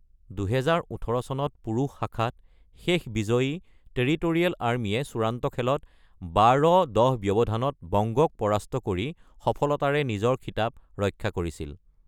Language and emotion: Assamese, neutral